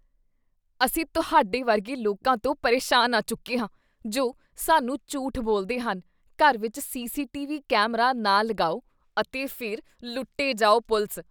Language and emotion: Punjabi, disgusted